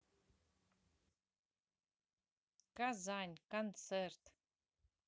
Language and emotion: Russian, neutral